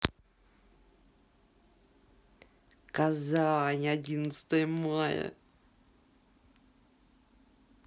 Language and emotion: Russian, sad